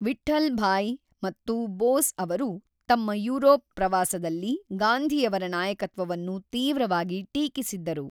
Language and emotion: Kannada, neutral